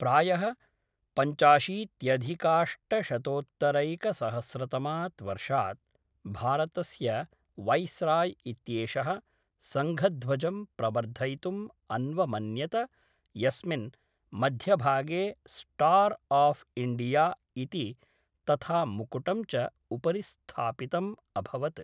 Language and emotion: Sanskrit, neutral